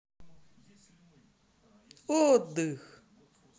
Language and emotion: Russian, positive